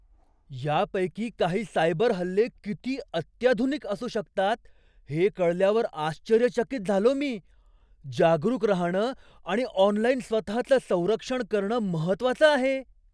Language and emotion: Marathi, surprised